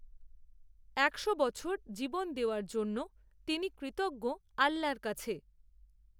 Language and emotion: Bengali, neutral